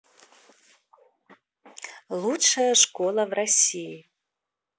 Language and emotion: Russian, neutral